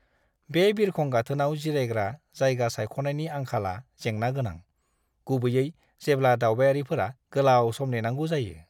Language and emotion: Bodo, disgusted